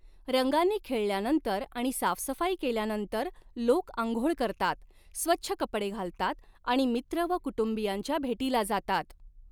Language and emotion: Marathi, neutral